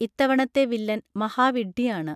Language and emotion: Malayalam, neutral